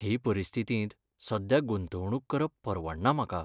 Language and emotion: Goan Konkani, sad